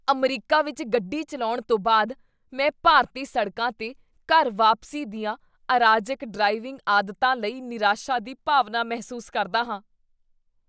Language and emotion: Punjabi, disgusted